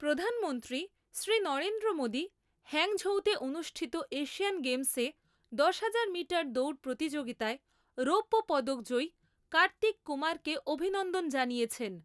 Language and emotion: Bengali, neutral